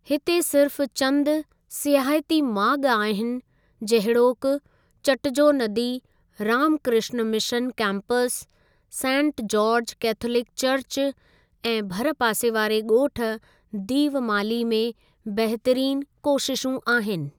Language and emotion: Sindhi, neutral